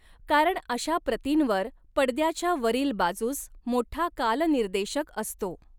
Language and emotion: Marathi, neutral